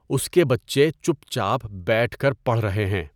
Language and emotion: Urdu, neutral